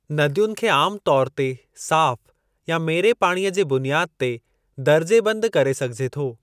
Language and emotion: Sindhi, neutral